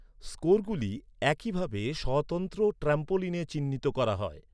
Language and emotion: Bengali, neutral